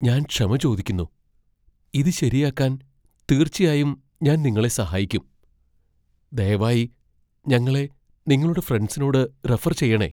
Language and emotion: Malayalam, fearful